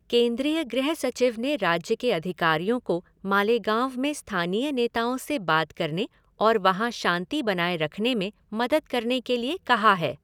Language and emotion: Hindi, neutral